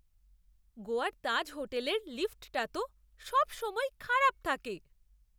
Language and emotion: Bengali, disgusted